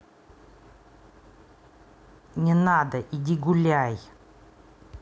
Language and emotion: Russian, angry